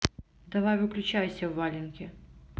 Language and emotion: Russian, neutral